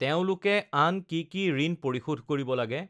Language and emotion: Assamese, neutral